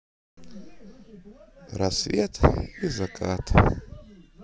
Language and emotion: Russian, sad